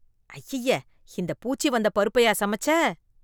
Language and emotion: Tamil, disgusted